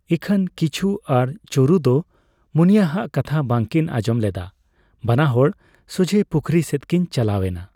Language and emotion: Santali, neutral